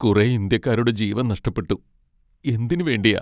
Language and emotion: Malayalam, sad